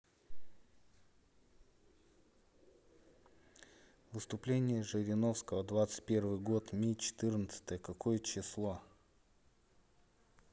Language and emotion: Russian, neutral